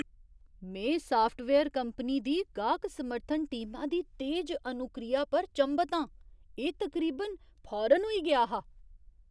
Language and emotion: Dogri, surprised